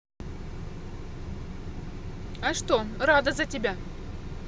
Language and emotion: Russian, positive